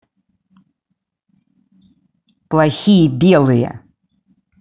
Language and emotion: Russian, angry